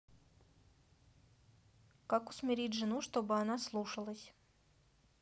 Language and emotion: Russian, neutral